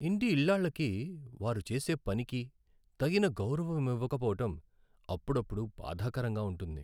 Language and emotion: Telugu, sad